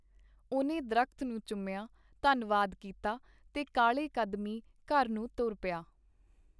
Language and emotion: Punjabi, neutral